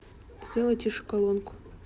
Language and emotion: Russian, neutral